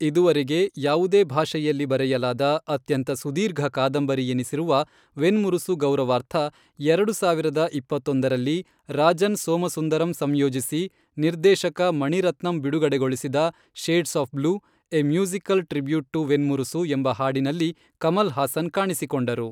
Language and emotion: Kannada, neutral